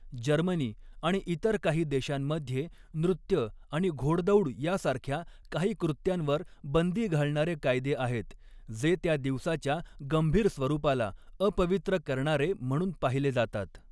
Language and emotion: Marathi, neutral